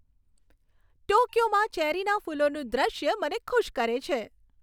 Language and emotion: Gujarati, happy